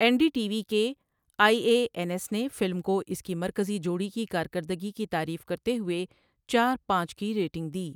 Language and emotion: Urdu, neutral